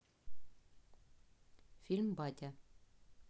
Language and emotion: Russian, neutral